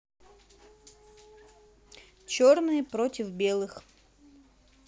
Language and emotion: Russian, neutral